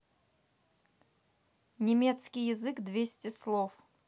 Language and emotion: Russian, neutral